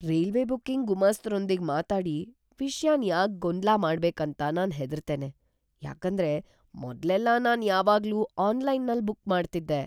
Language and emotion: Kannada, fearful